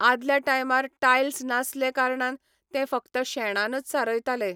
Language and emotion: Goan Konkani, neutral